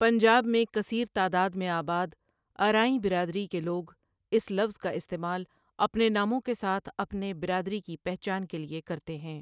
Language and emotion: Urdu, neutral